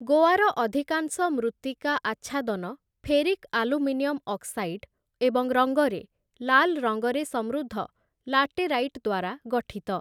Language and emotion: Odia, neutral